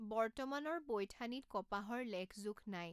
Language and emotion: Assamese, neutral